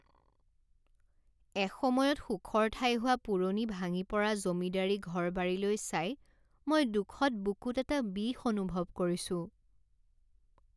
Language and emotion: Assamese, sad